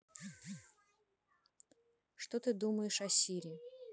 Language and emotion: Russian, neutral